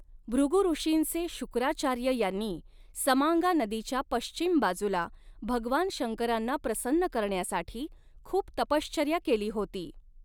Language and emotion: Marathi, neutral